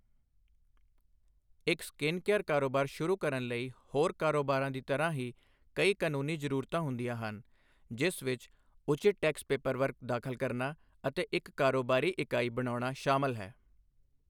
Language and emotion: Punjabi, neutral